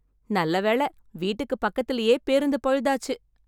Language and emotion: Tamil, happy